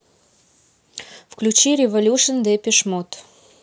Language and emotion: Russian, neutral